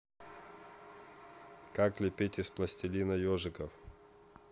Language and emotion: Russian, neutral